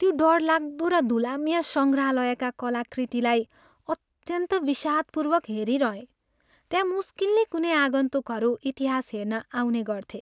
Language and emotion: Nepali, sad